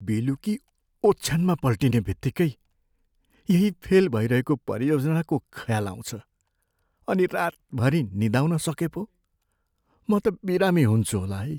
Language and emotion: Nepali, fearful